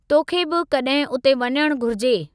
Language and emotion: Sindhi, neutral